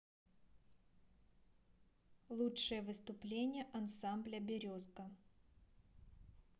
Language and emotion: Russian, neutral